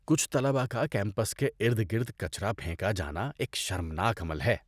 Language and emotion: Urdu, disgusted